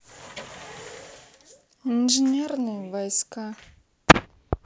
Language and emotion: Russian, sad